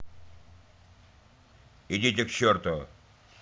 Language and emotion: Russian, angry